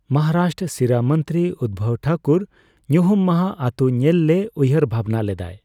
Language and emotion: Santali, neutral